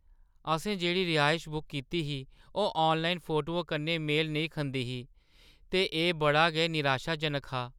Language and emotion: Dogri, sad